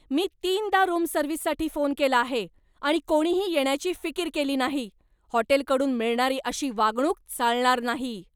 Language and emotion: Marathi, angry